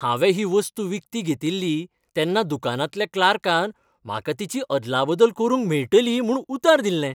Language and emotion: Goan Konkani, happy